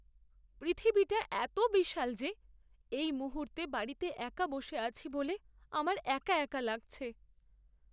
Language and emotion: Bengali, sad